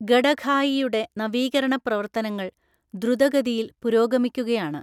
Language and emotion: Malayalam, neutral